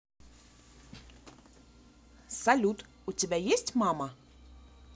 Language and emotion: Russian, positive